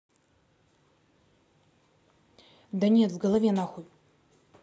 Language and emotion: Russian, angry